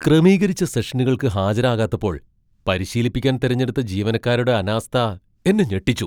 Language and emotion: Malayalam, surprised